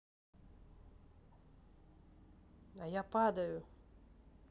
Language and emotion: Russian, neutral